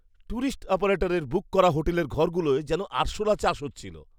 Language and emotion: Bengali, disgusted